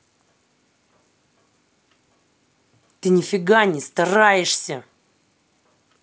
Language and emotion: Russian, angry